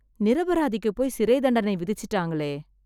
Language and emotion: Tamil, sad